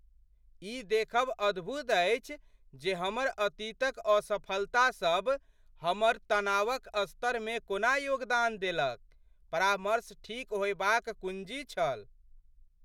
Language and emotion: Maithili, surprised